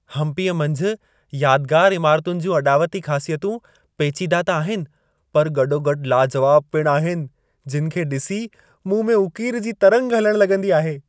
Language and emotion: Sindhi, happy